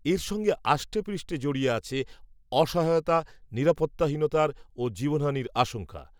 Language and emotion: Bengali, neutral